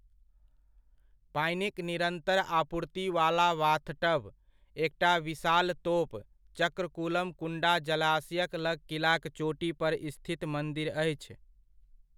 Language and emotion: Maithili, neutral